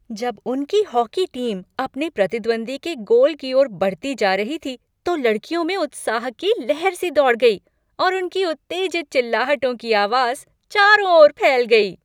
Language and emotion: Hindi, happy